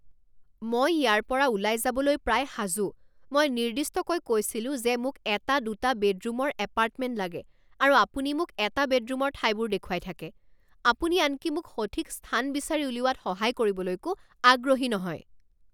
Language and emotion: Assamese, angry